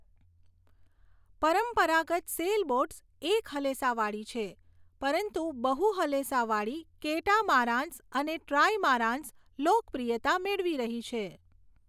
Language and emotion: Gujarati, neutral